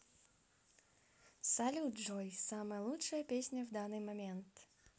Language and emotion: Russian, positive